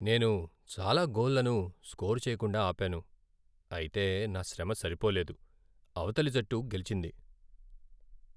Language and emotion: Telugu, sad